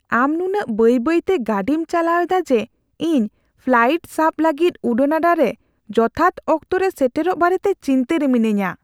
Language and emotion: Santali, fearful